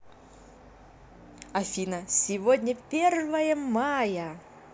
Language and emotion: Russian, positive